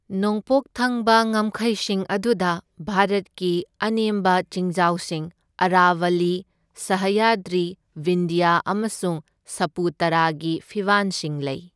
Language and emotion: Manipuri, neutral